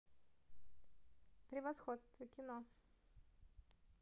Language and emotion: Russian, positive